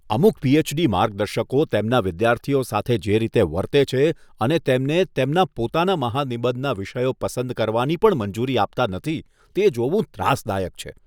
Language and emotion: Gujarati, disgusted